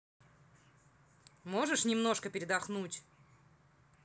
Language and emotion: Russian, angry